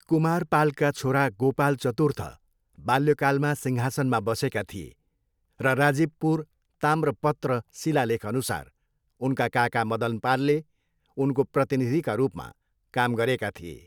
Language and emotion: Nepali, neutral